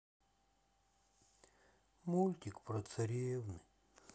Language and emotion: Russian, sad